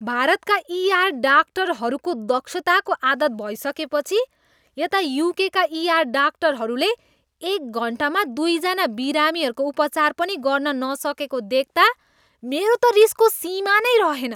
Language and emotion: Nepali, disgusted